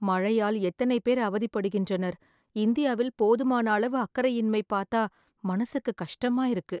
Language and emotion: Tamil, sad